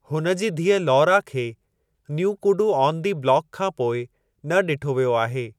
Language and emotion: Sindhi, neutral